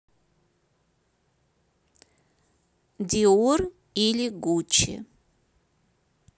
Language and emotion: Russian, neutral